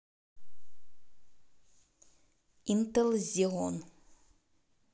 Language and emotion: Russian, neutral